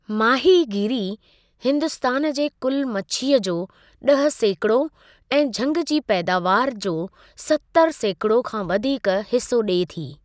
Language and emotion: Sindhi, neutral